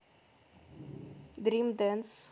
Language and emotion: Russian, neutral